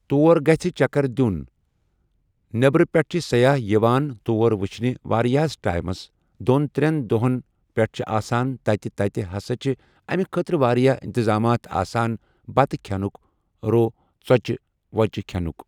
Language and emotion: Kashmiri, neutral